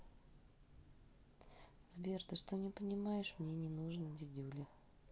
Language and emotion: Russian, neutral